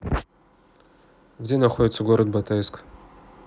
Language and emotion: Russian, neutral